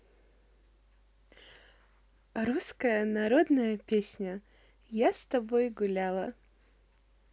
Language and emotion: Russian, positive